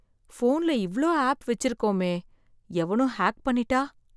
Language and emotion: Tamil, fearful